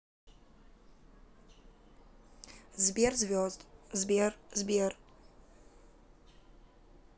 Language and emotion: Russian, neutral